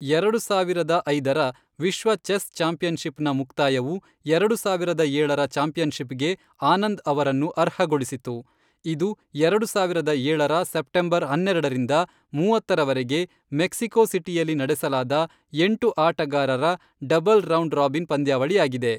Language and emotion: Kannada, neutral